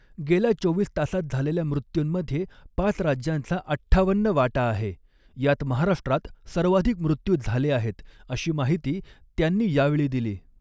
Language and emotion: Marathi, neutral